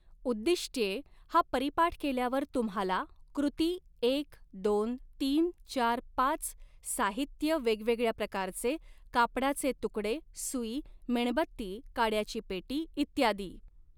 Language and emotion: Marathi, neutral